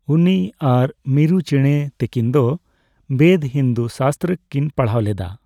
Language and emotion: Santali, neutral